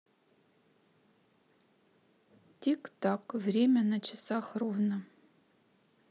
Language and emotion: Russian, neutral